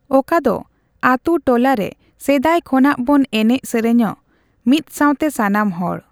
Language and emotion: Santali, neutral